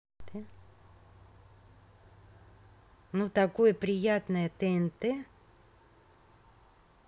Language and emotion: Russian, positive